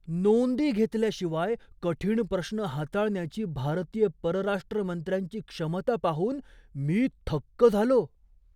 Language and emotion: Marathi, surprised